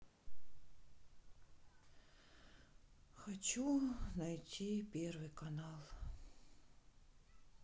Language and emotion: Russian, sad